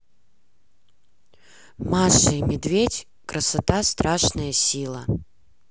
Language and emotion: Russian, neutral